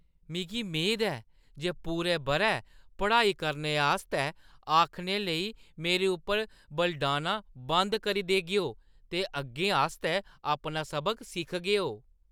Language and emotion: Dogri, disgusted